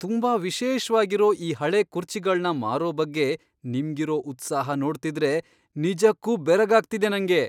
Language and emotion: Kannada, surprised